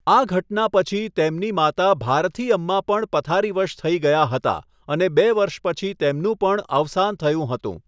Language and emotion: Gujarati, neutral